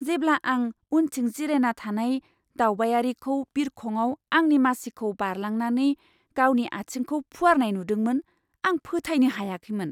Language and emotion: Bodo, surprised